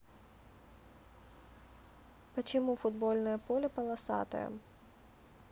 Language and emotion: Russian, neutral